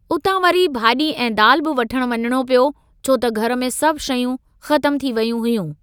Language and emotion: Sindhi, neutral